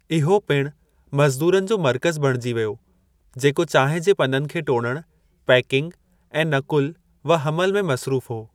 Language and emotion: Sindhi, neutral